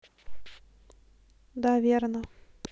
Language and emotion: Russian, neutral